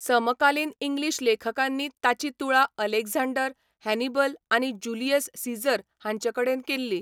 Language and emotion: Goan Konkani, neutral